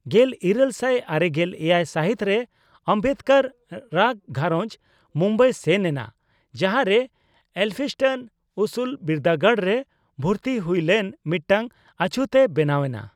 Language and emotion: Santali, neutral